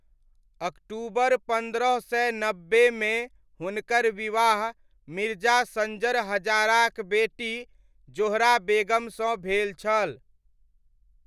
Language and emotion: Maithili, neutral